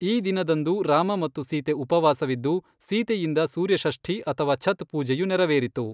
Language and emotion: Kannada, neutral